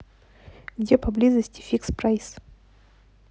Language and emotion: Russian, neutral